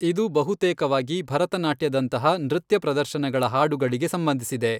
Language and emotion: Kannada, neutral